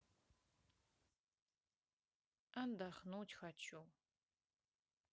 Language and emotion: Russian, sad